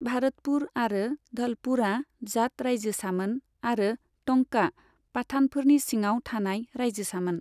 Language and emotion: Bodo, neutral